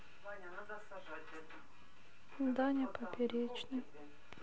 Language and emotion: Russian, sad